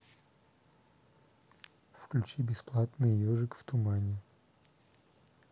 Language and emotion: Russian, neutral